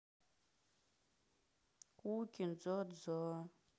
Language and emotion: Russian, sad